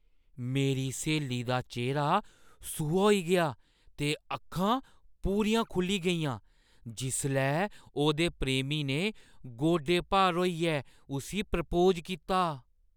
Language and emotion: Dogri, surprised